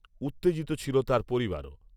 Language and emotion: Bengali, neutral